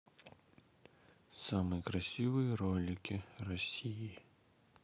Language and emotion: Russian, sad